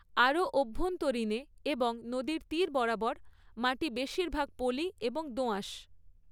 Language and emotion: Bengali, neutral